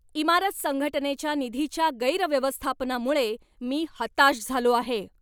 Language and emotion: Marathi, angry